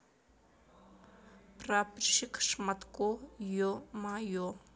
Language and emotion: Russian, neutral